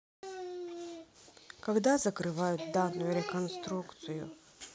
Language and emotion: Russian, neutral